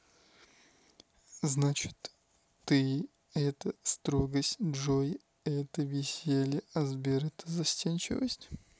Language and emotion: Russian, neutral